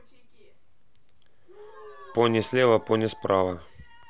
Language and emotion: Russian, neutral